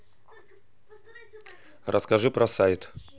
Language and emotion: Russian, neutral